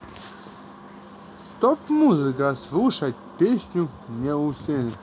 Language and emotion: Russian, positive